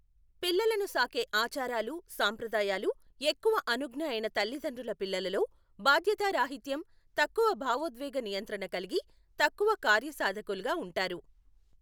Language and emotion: Telugu, neutral